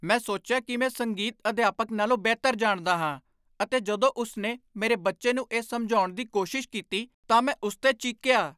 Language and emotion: Punjabi, angry